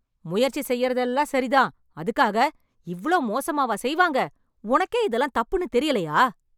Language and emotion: Tamil, angry